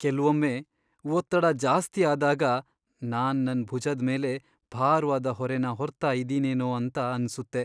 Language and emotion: Kannada, sad